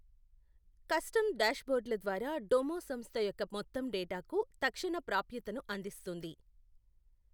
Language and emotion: Telugu, neutral